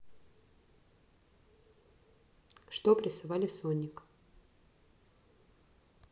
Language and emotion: Russian, neutral